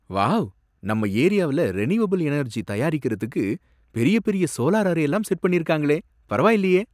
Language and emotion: Tamil, surprised